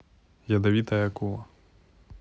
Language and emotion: Russian, neutral